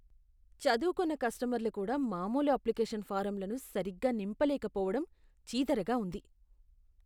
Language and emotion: Telugu, disgusted